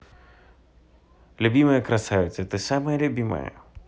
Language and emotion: Russian, positive